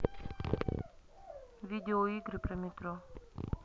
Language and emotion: Russian, neutral